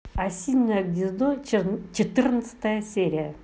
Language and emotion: Russian, neutral